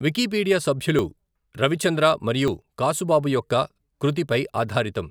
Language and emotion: Telugu, neutral